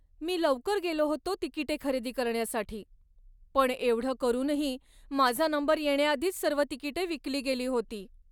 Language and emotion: Marathi, sad